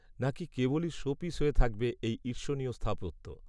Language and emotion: Bengali, neutral